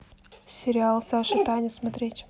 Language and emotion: Russian, neutral